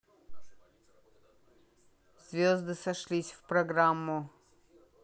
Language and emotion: Russian, neutral